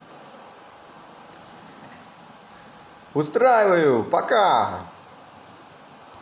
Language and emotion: Russian, positive